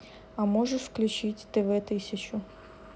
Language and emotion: Russian, neutral